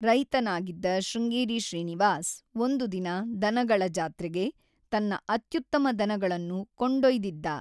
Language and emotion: Kannada, neutral